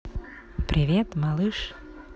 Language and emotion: Russian, positive